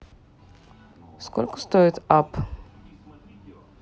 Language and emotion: Russian, neutral